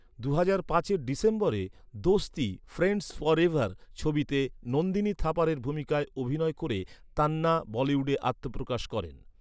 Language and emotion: Bengali, neutral